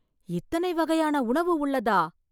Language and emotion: Tamil, surprised